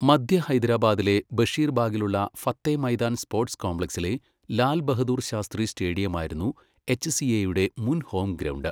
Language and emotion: Malayalam, neutral